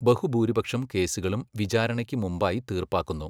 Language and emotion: Malayalam, neutral